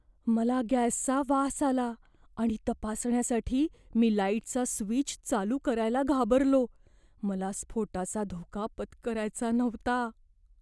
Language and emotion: Marathi, fearful